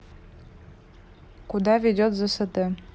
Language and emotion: Russian, neutral